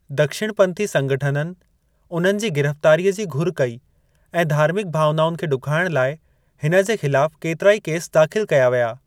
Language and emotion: Sindhi, neutral